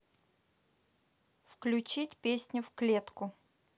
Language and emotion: Russian, neutral